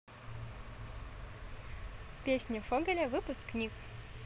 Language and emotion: Russian, positive